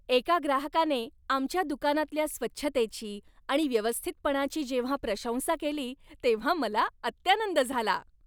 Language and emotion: Marathi, happy